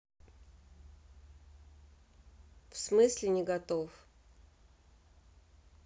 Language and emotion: Russian, neutral